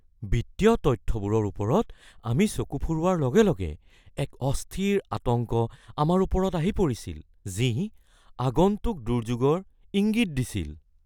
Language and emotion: Assamese, fearful